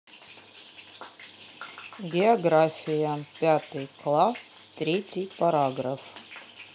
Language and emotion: Russian, neutral